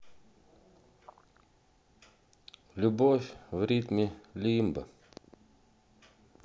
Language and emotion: Russian, sad